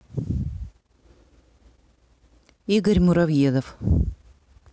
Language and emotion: Russian, neutral